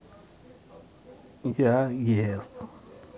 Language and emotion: Russian, positive